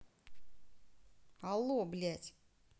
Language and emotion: Russian, angry